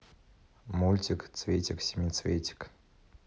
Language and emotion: Russian, neutral